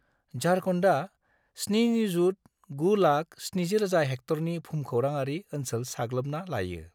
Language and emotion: Bodo, neutral